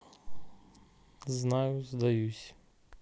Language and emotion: Russian, sad